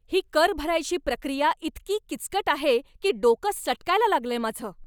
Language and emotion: Marathi, angry